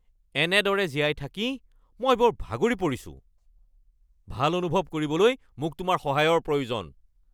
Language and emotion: Assamese, angry